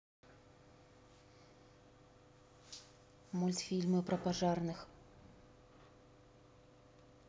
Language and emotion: Russian, neutral